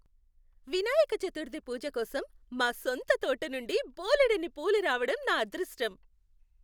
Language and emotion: Telugu, happy